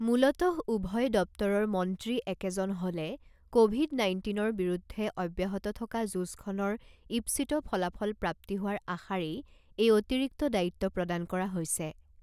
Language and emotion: Assamese, neutral